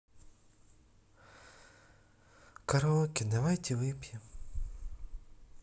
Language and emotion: Russian, sad